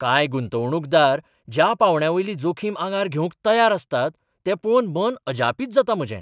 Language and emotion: Goan Konkani, surprised